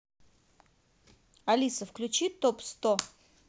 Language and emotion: Russian, positive